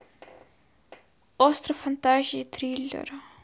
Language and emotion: Russian, sad